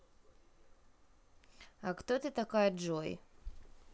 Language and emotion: Russian, neutral